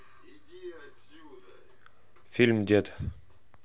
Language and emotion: Russian, neutral